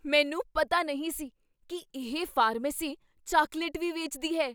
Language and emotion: Punjabi, surprised